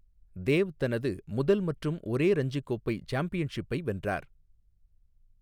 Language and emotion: Tamil, neutral